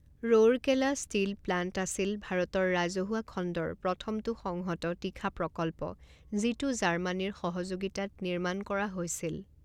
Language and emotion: Assamese, neutral